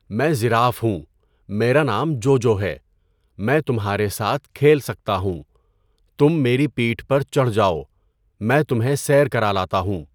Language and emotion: Urdu, neutral